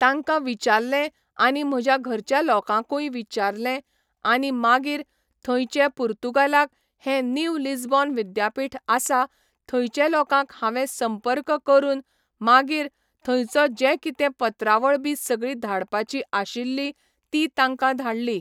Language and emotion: Goan Konkani, neutral